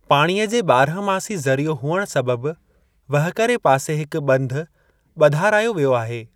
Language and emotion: Sindhi, neutral